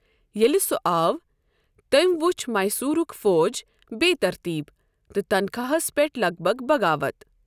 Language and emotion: Kashmiri, neutral